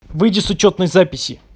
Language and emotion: Russian, angry